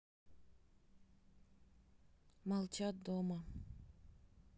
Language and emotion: Russian, sad